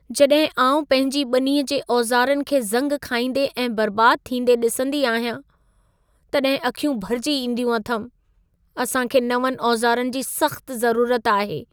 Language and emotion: Sindhi, sad